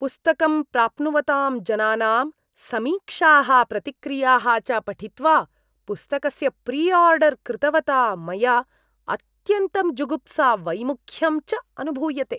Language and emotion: Sanskrit, disgusted